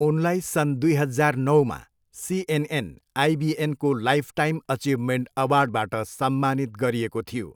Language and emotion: Nepali, neutral